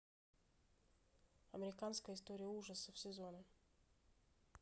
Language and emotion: Russian, neutral